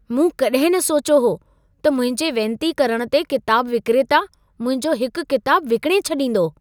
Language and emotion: Sindhi, surprised